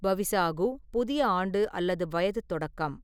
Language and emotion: Tamil, neutral